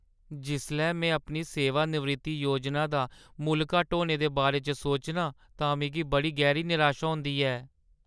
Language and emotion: Dogri, sad